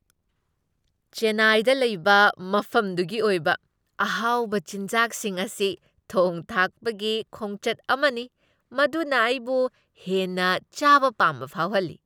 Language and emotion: Manipuri, happy